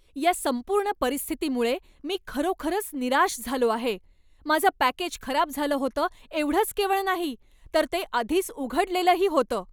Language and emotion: Marathi, angry